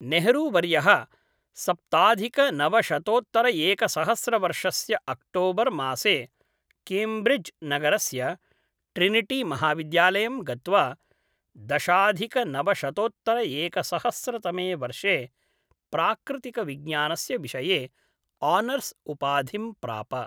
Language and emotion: Sanskrit, neutral